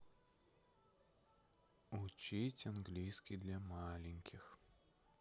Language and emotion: Russian, neutral